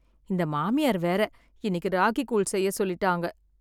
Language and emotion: Tamil, sad